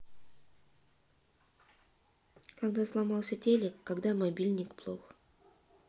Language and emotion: Russian, neutral